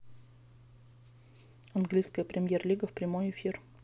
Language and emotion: Russian, neutral